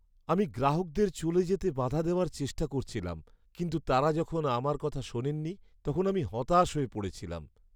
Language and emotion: Bengali, sad